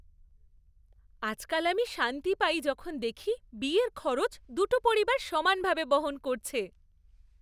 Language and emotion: Bengali, happy